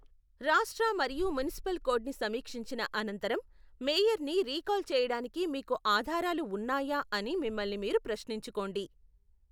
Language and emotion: Telugu, neutral